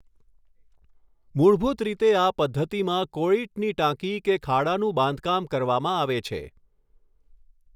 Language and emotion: Gujarati, neutral